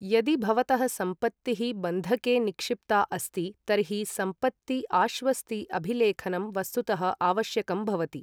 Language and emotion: Sanskrit, neutral